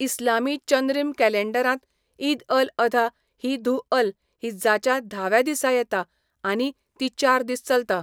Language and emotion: Goan Konkani, neutral